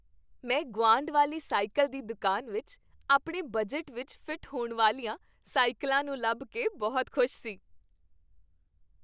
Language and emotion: Punjabi, happy